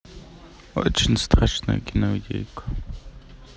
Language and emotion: Russian, neutral